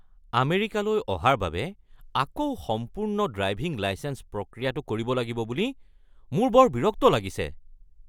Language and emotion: Assamese, angry